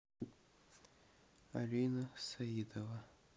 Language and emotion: Russian, neutral